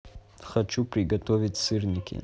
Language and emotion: Russian, neutral